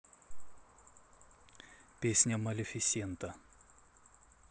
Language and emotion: Russian, neutral